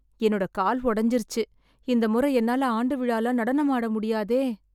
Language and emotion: Tamil, sad